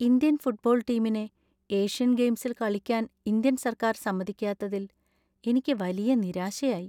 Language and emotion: Malayalam, sad